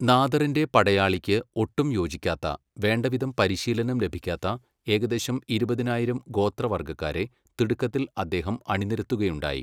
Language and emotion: Malayalam, neutral